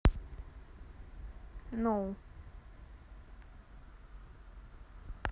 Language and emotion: Russian, neutral